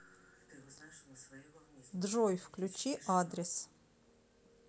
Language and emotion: Russian, neutral